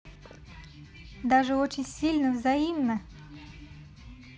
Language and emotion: Russian, positive